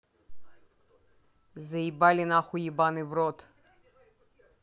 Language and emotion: Russian, angry